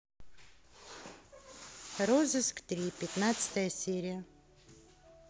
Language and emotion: Russian, neutral